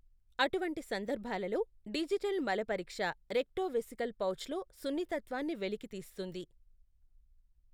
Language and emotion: Telugu, neutral